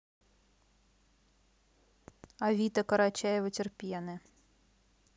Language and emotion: Russian, neutral